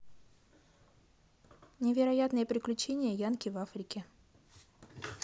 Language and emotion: Russian, neutral